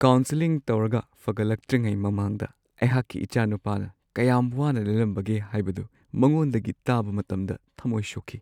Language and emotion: Manipuri, sad